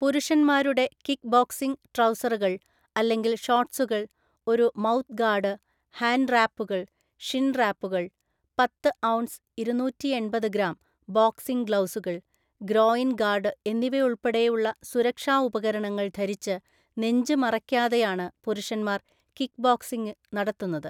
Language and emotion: Malayalam, neutral